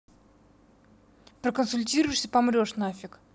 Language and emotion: Russian, angry